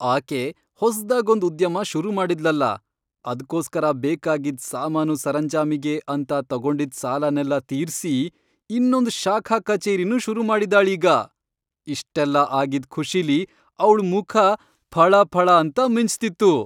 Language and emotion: Kannada, happy